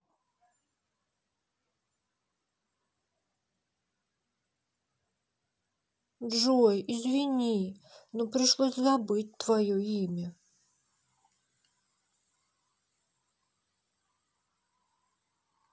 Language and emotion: Russian, sad